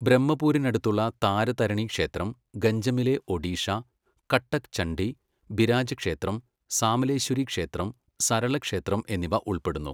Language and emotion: Malayalam, neutral